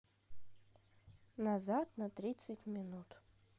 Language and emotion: Russian, neutral